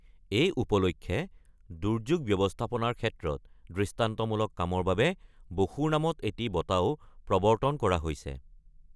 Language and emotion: Assamese, neutral